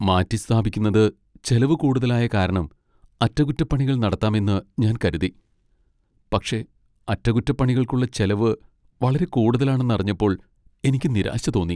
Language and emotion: Malayalam, sad